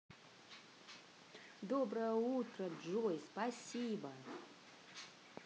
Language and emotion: Russian, positive